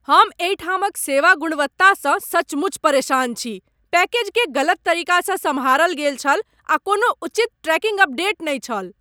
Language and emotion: Maithili, angry